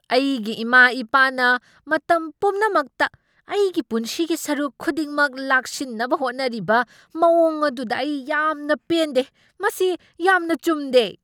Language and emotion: Manipuri, angry